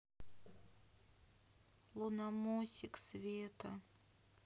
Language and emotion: Russian, sad